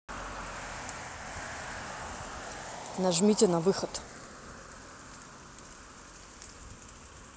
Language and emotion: Russian, neutral